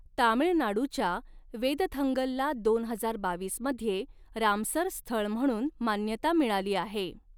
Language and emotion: Marathi, neutral